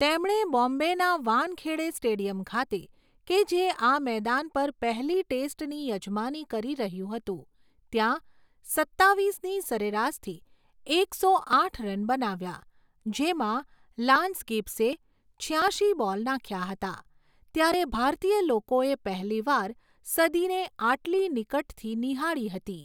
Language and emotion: Gujarati, neutral